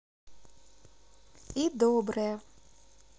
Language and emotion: Russian, positive